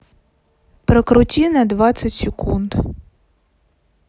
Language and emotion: Russian, neutral